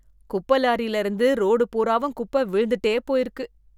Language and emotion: Tamil, disgusted